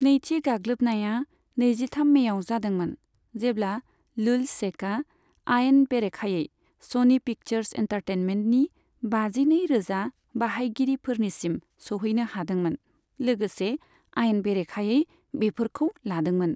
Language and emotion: Bodo, neutral